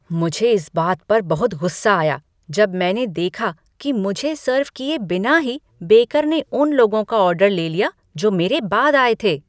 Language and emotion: Hindi, angry